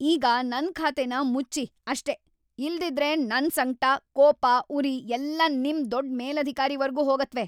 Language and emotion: Kannada, angry